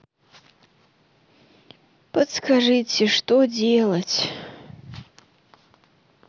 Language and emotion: Russian, sad